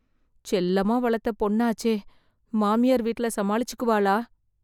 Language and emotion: Tamil, fearful